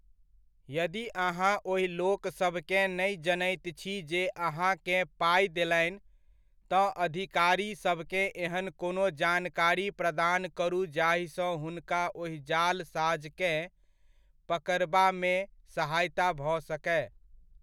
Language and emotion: Maithili, neutral